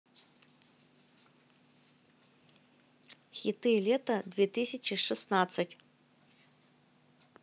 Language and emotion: Russian, positive